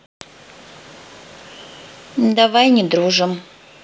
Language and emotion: Russian, neutral